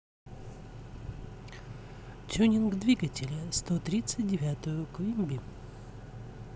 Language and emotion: Russian, neutral